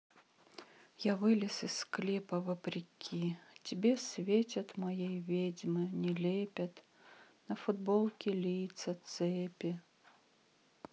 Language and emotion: Russian, sad